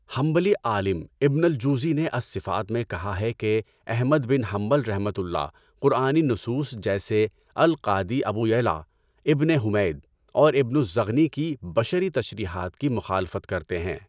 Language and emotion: Urdu, neutral